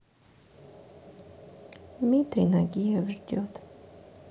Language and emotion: Russian, sad